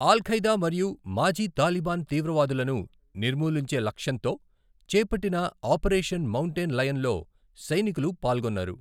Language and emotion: Telugu, neutral